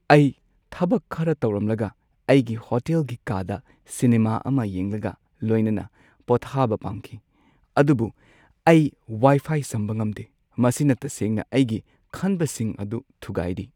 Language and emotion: Manipuri, sad